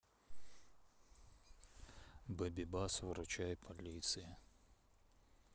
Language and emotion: Russian, neutral